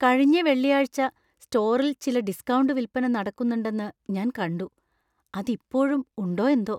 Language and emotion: Malayalam, fearful